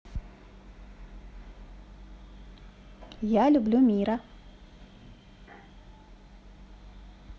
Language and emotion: Russian, positive